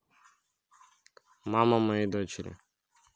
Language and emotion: Russian, neutral